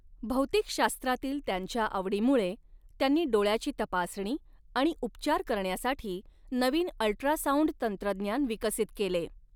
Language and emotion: Marathi, neutral